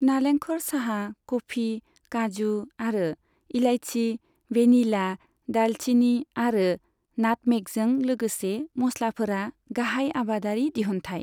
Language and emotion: Bodo, neutral